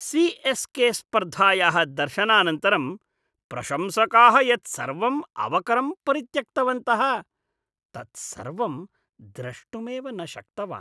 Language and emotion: Sanskrit, disgusted